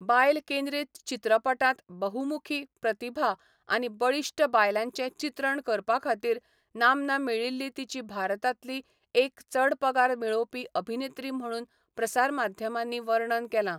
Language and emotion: Goan Konkani, neutral